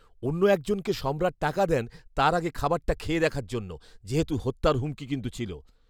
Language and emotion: Bengali, fearful